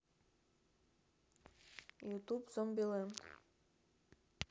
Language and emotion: Russian, neutral